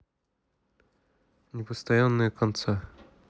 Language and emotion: Russian, neutral